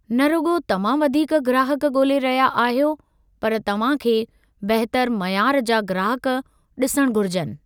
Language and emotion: Sindhi, neutral